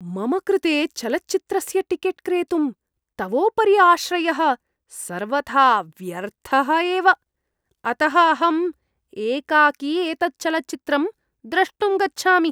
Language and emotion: Sanskrit, disgusted